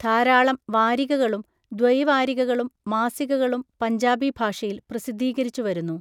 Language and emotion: Malayalam, neutral